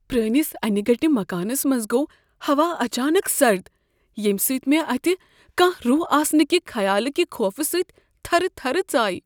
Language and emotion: Kashmiri, fearful